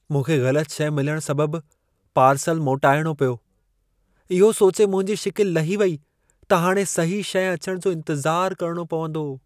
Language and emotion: Sindhi, sad